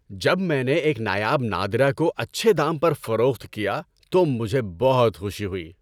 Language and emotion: Urdu, happy